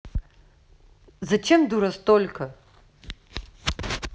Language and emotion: Russian, angry